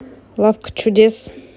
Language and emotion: Russian, neutral